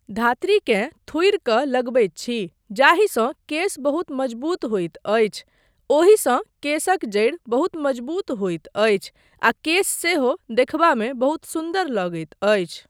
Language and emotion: Maithili, neutral